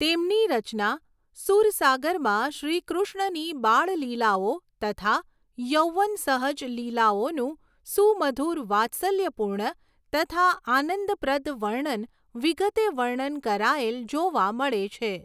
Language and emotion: Gujarati, neutral